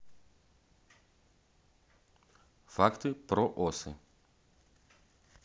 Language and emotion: Russian, neutral